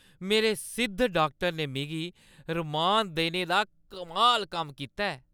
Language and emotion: Dogri, happy